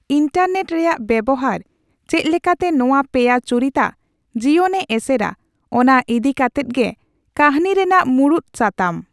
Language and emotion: Santali, neutral